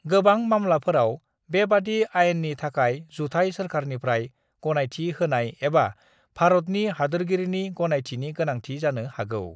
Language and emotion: Bodo, neutral